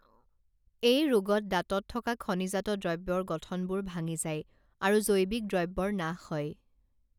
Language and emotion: Assamese, neutral